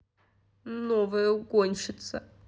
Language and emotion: Russian, angry